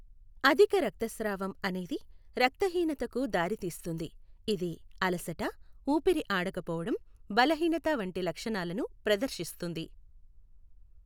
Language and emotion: Telugu, neutral